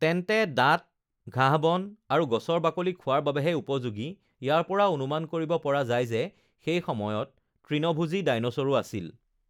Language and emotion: Assamese, neutral